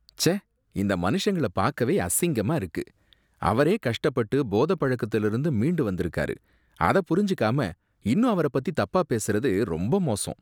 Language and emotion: Tamil, disgusted